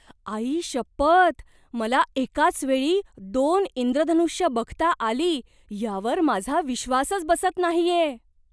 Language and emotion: Marathi, surprised